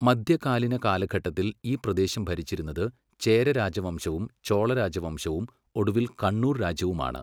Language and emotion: Malayalam, neutral